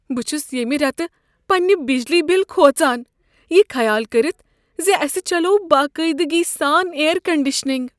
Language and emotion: Kashmiri, fearful